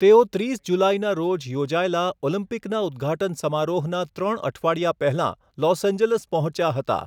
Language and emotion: Gujarati, neutral